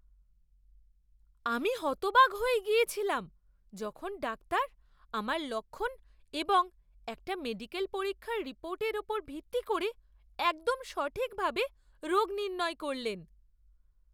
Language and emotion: Bengali, surprised